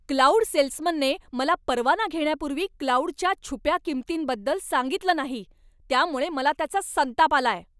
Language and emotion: Marathi, angry